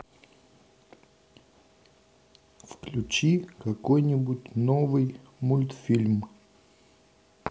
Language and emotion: Russian, neutral